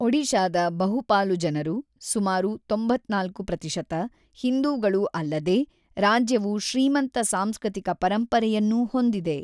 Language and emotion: Kannada, neutral